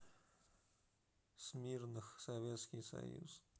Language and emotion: Russian, neutral